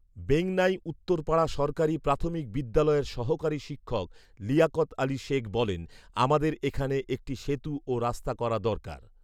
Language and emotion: Bengali, neutral